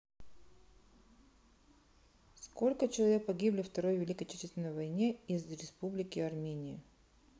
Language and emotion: Russian, neutral